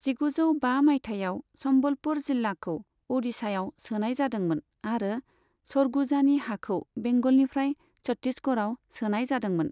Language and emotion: Bodo, neutral